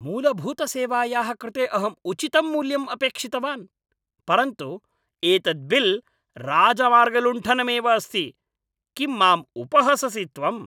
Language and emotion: Sanskrit, angry